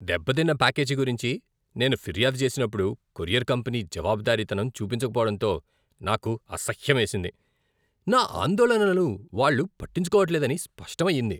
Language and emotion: Telugu, disgusted